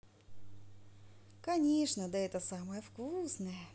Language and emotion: Russian, positive